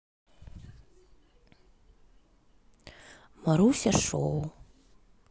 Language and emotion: Russian, sad